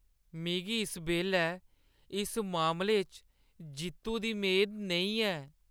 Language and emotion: Dogri, sad